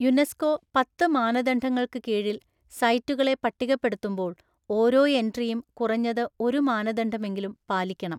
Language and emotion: Malayalam, neutral